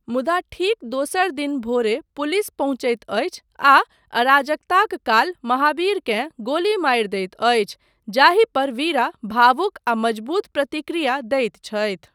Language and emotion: Maithili, neutral